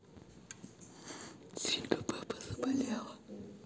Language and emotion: Russian, neutral